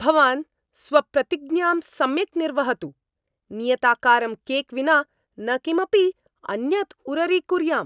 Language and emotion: Sanskrit, angry